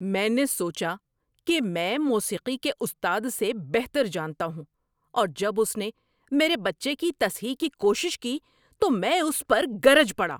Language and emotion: Urdu, angry